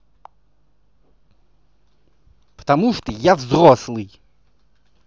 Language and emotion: Russian, angry